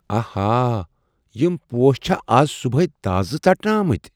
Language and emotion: Kashmiri, surprised